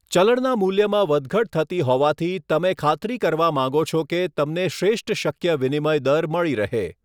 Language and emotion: Gujarati, neutral